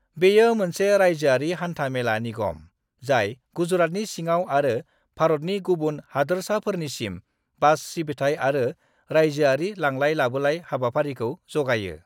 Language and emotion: Bodo, neutral